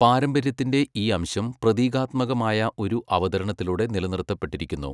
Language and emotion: Malayalam, neutral